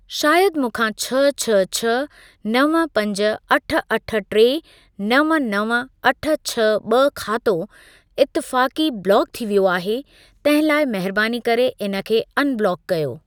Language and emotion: Sindhi, neutral